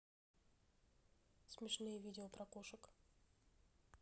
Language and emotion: Russian, neutral